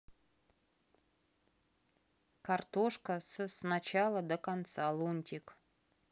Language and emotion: Russian, neutral